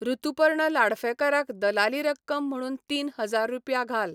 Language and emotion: Goan Konkani, neutral